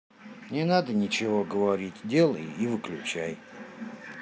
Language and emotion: Russian, sad